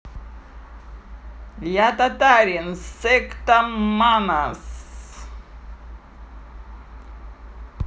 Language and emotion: Russian, positive